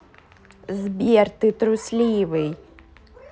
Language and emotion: Russian, neutral